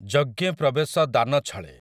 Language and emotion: Odia, neutral